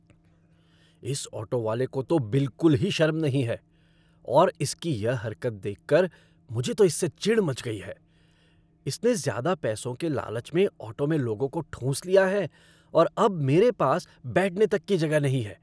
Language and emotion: Hindi, angry